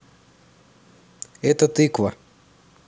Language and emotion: Russian, neutral